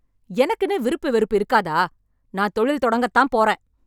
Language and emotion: Tamil, angry